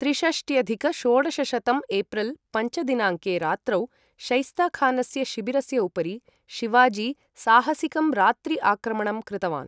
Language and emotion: Sanskrit, neutral